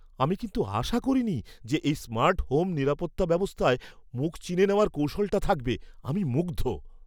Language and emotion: Bengali, surprised